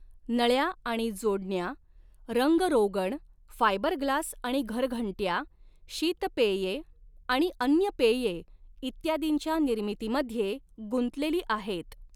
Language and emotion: Marathi, neutral